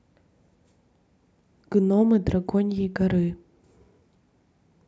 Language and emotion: Russian, neutral